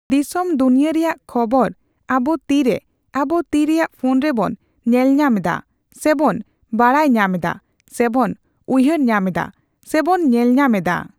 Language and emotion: Santali, neutral